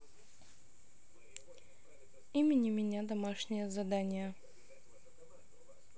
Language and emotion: Russian, neutral